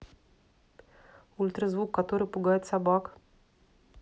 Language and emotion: Russian, neutral